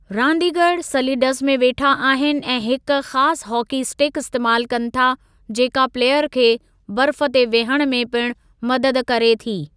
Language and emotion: Sindhi, neutral